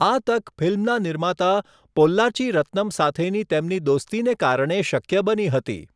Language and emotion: Gujarati, neutral